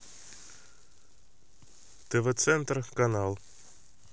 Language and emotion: Russian, neutral